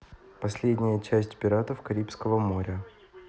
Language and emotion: Russian, neutral